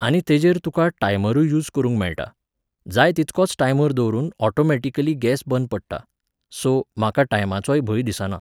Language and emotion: Goan Konkani, neutral